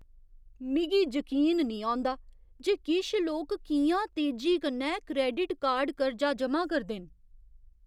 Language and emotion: Dogri, surprised